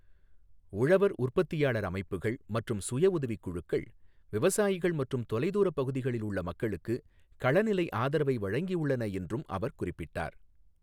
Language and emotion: Tamil, neutral